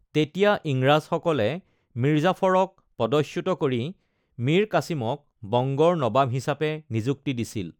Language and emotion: Assamese, neutral